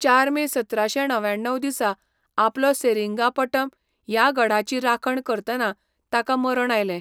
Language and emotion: Goan Konkani, neutral